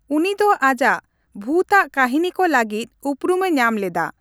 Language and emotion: Santali, neutral